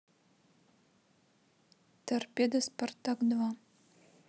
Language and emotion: Russian, neutral